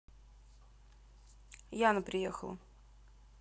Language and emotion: Russian, neutral